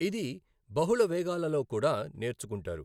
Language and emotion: Telugu, neutral